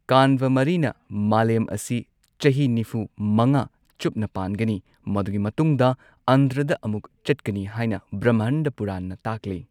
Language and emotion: Manipuri, neutral